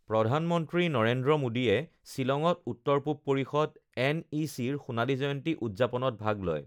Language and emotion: Assamese, neutral